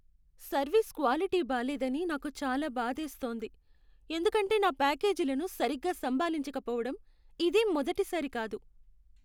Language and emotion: Telugu, sad